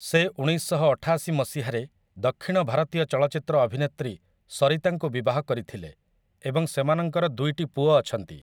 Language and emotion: Odia, neutral